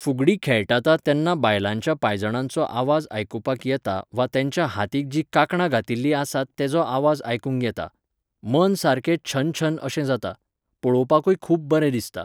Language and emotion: Goan Konkani, neutral